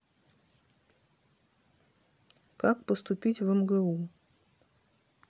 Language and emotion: Russian, neutral